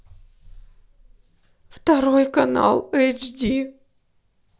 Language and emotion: Russian, sad